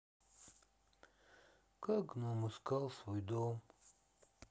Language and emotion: Russian, sad